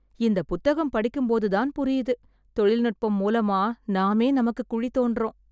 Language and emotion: Tamil, sad